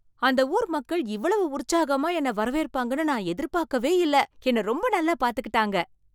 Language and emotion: Tamil, surprised